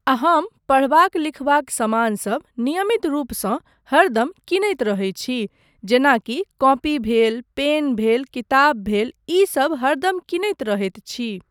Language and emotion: Maithili, neutral